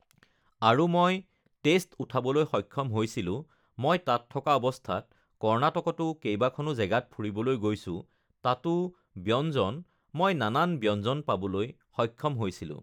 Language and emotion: Assamese, neutral